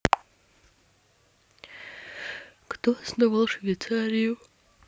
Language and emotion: Russian, neutral